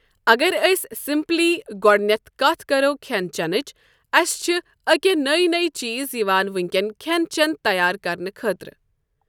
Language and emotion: Kashmiri, neutral